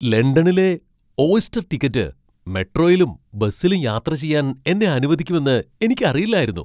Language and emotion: Malayalam, surprised